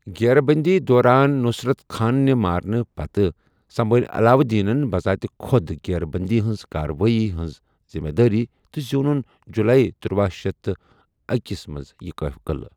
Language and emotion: Kashmiri, neutral